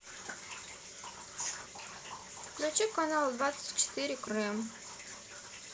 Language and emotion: Russian, neutral